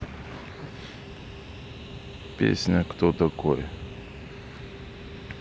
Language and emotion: Russian, neutral